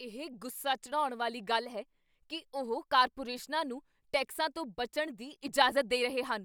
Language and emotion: Punjabi, angry